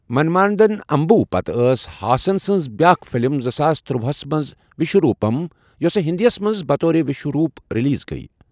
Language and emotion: Kashmiri, neutral